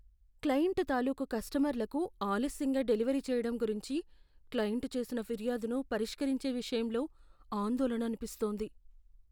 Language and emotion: Telugu, fearful